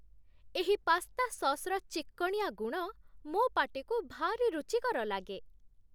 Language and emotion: Odia, happy